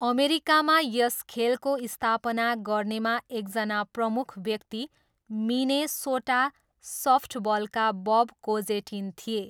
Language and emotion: Nepali, neutral